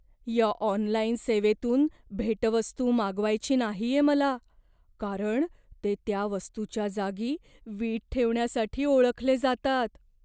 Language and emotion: Marathi, fearful